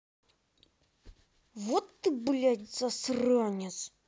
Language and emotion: Russian, angry